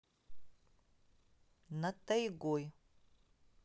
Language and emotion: Russian, neutral